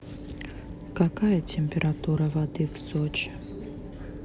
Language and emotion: Russian, sad